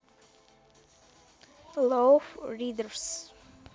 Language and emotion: Russian, neutral